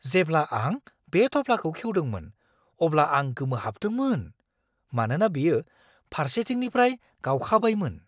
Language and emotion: Bodo, surprised